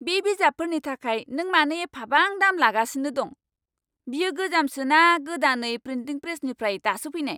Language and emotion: Bodo, angry